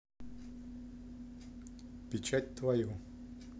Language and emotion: Russian, neutral